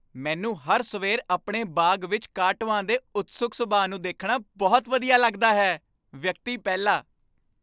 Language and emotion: Punjabi, happy